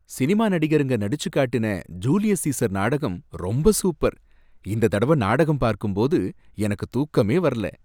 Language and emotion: Tamil, happy